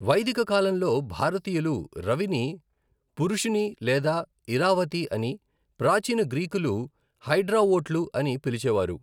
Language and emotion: Telugu, neutral